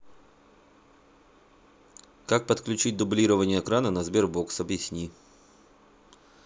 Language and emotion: Russian, neutral